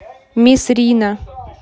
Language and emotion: Russian, neutral